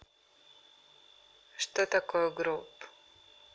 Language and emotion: Russian, neutral